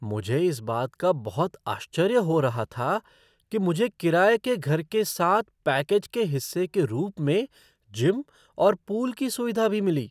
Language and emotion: Hindi, surprised